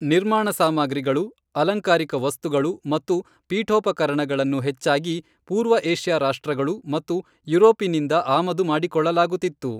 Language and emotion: Kannada, neutral